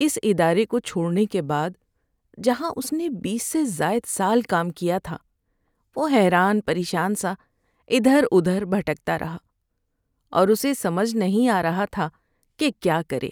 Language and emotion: Urdu, sad